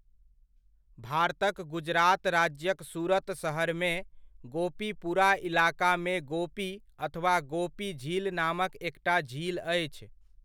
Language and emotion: Maithili, neutral